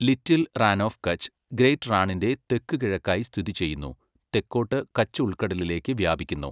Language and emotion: Malayalam, neutral